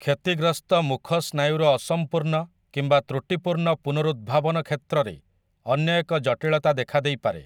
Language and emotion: Odia, neutral